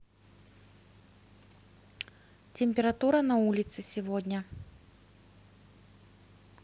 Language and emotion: Russian, neutral